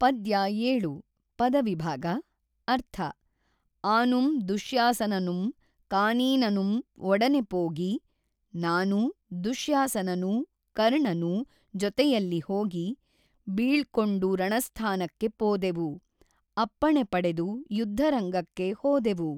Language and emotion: Kannada, neutral